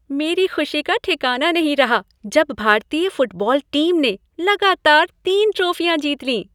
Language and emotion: Hindi, happy